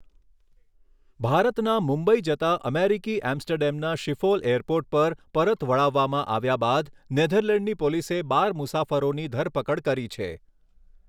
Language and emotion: Gujarati, neutral